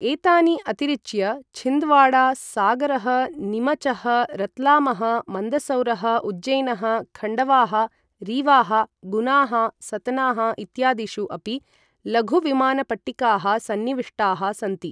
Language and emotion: Sanskrit, neutral